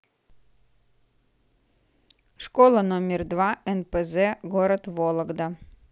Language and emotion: Russian, neutral